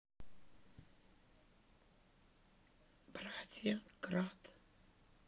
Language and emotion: Russian, sad